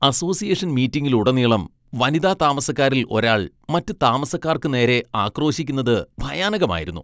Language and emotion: Malayalam, disgusted